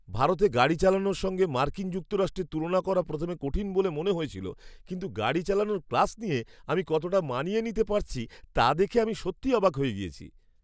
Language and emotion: Bengali, surprised